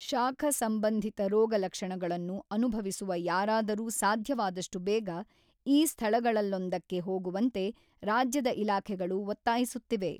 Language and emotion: Kannada, neutral